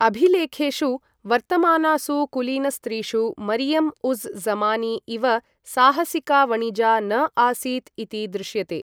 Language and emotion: Sanskrit, neutral